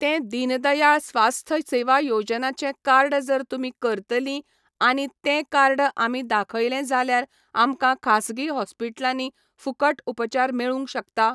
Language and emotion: Goan Konkani, neutral